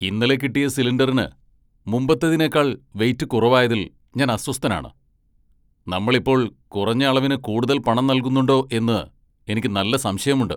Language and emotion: Malayalam, angry